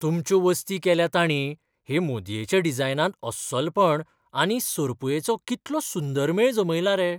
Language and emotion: Goan Konkani, surprised